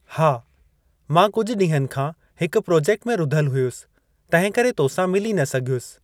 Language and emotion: Sindhi, neutral